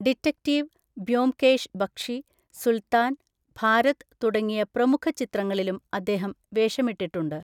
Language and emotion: Malayalam, neutral